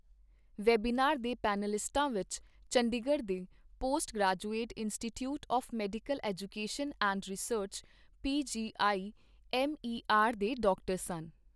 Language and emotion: Punjabi, neutral